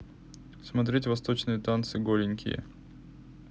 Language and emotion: Russian, neutral